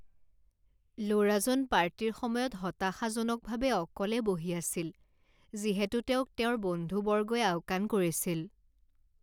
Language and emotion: Assamese, sad